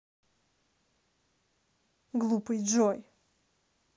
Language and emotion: Russian, angry